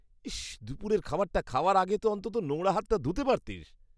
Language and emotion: Bengali, disgusted